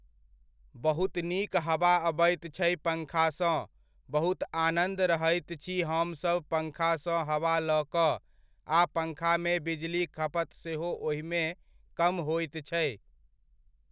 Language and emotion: Maithili, neutral